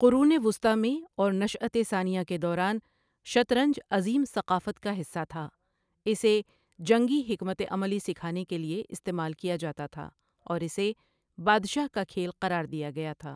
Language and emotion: Urdu, neutral